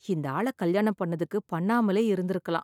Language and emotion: Tamil, sad